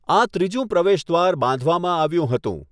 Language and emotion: Gujarati, neutral